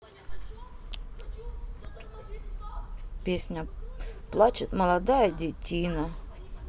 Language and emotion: Russian, neutral